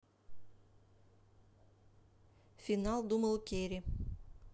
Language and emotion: Russian, neutral